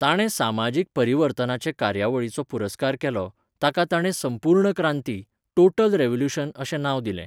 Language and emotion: Goan Konkani, neutral